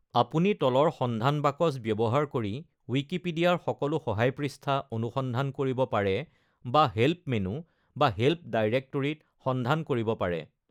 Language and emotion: Assamese, neutral